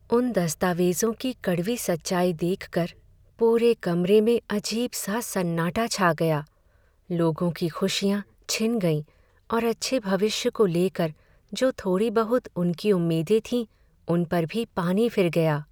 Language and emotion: Hindi, sad